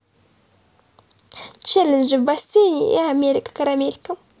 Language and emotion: Russian, positive